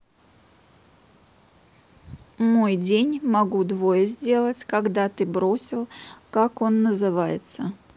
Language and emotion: Russian, neutral